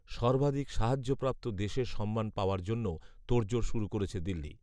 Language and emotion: Bengali, neutral